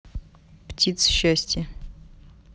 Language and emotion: Russian, neutral